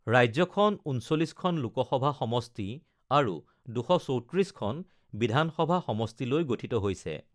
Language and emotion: Assamese, neutral